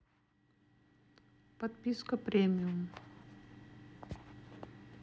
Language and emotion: Russian, neutral